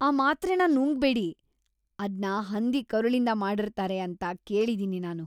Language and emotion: Kannada, disgusted